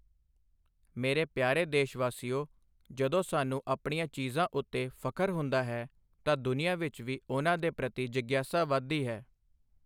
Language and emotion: Punjabi, neutral